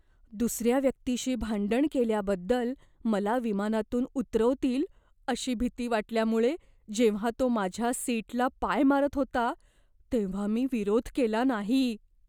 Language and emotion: Marathi, fearful